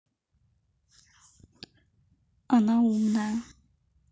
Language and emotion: Russian, neutral